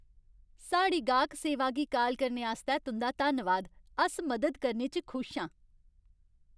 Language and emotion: Dogri, happy